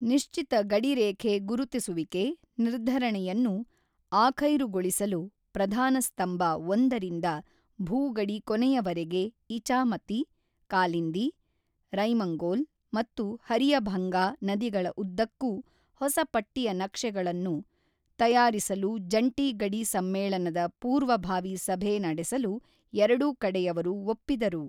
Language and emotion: Kannada, neutral